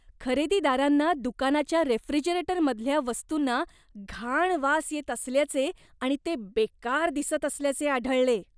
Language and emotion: Marathi, disgusted